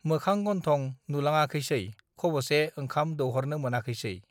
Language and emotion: Bodo, neutral